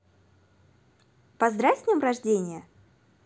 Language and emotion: Russian, positive